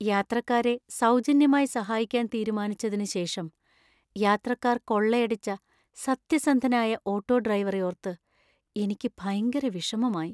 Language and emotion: Malayalam, sad